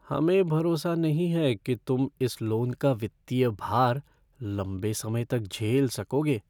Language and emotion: Hindi, fearful